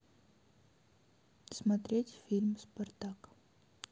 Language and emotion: Russian, neutral